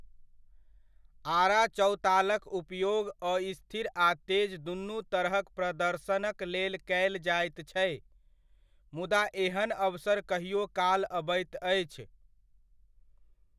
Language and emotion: Maithili, neutral